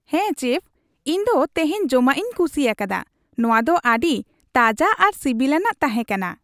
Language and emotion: Santali, happy